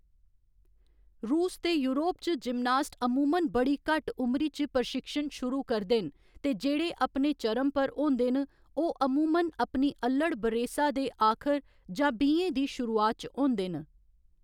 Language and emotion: Dogri, neutral